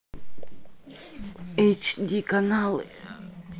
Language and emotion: Russian, neutral